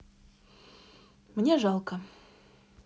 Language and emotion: Russian, sad